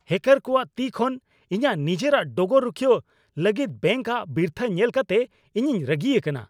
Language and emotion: Santali, angry